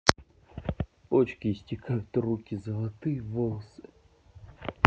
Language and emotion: Russian, neutral